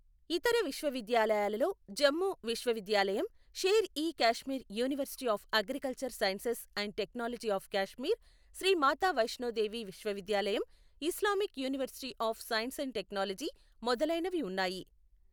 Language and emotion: Telugu, neutral